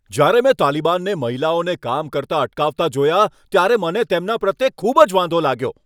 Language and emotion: Gujarati, angry